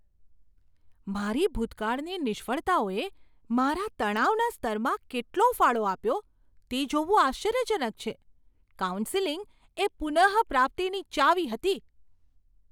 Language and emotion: Gujarati, surprised